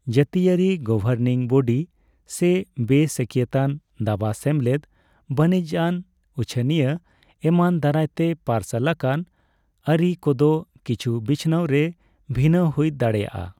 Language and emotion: Santali, neutral